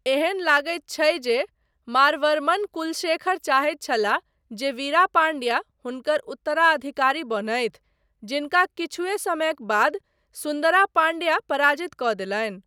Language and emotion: Maithili, neutral